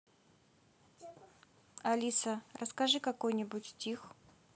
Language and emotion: Russian, neutral